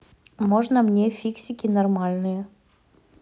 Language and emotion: Russian, neutral